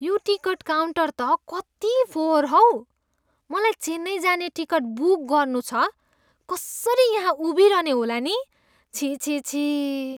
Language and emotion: Nepali, disgusted